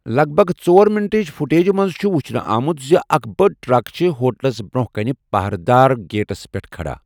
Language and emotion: Kashmiri, neutral